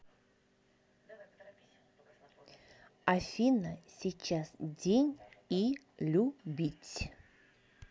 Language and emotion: Russian, neutral